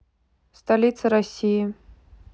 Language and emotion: Russian, neutral